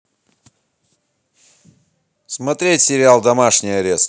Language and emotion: Russian, positive